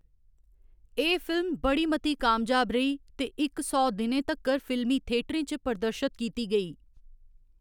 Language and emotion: Dogri, neutral